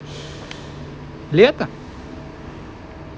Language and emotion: Russian, positive